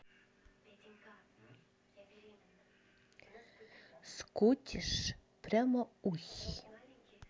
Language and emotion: Russian, neutral